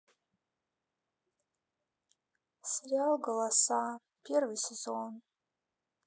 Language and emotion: Russian, sad